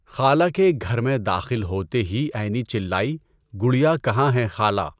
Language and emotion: Urdu, neutral